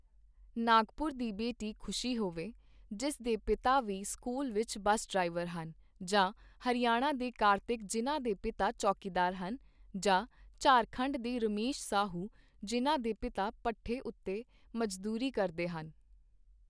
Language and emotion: Punjabi, neutral